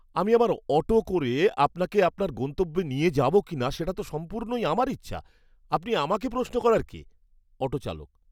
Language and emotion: Bengali, angry